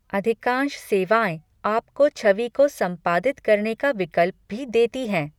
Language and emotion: Hindi, neutral